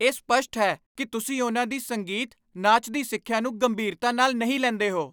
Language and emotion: Punjabi, angry